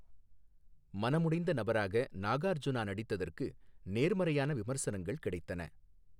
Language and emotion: Tamil, neutral